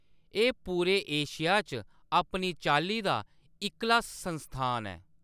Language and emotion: Dogri, neutral